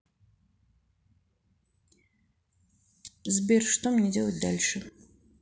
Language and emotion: Russian, neutral